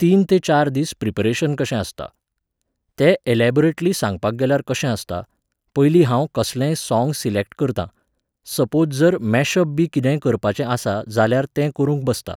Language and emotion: Goan Konkani, neutral